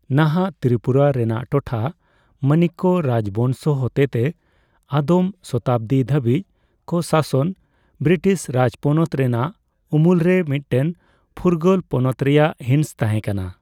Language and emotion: Santali, neutral